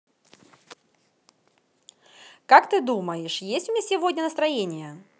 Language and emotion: Russian, positive